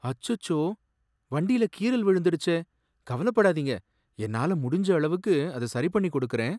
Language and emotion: Tamil, sad